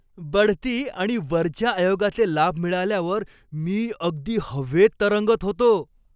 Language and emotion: Marathi, happy